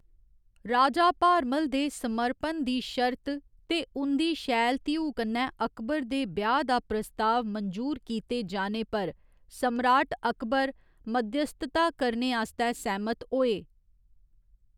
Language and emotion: Dogri, neutral